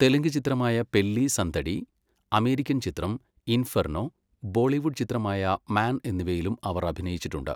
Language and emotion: Malayalam, neutral